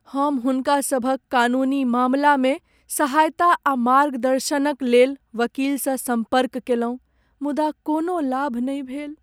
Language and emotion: Maithili, sad